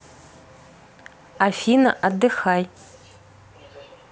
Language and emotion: Russian, neutral